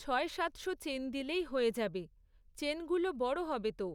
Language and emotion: Bengali, neutral